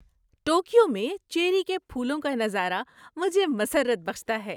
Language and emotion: Urdu, happy